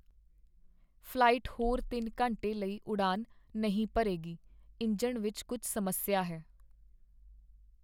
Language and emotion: Punjabi, sad